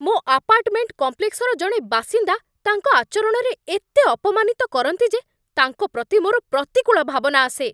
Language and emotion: Odia, angry